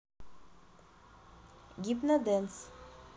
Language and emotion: Russian, neutral